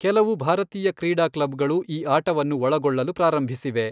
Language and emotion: Kannada, neutral